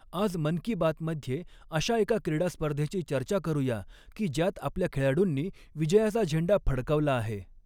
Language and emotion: Marathi, neutral